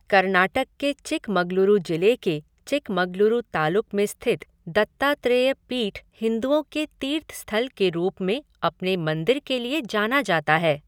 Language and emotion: Hindi, neutral